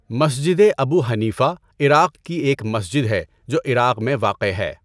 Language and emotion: Urdu, neutral